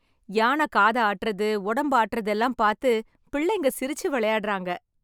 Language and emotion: Tamil, happy